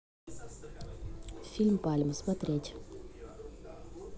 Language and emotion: Russian, neutral